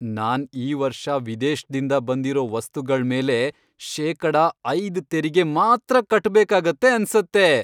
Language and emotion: Kannada, happy